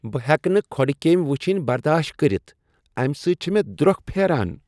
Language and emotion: Kashmiri, disgusted